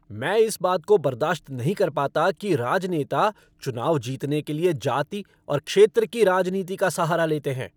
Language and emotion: Hindi, angry